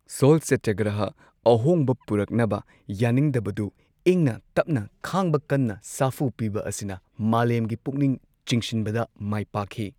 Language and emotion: Manipuri, neutral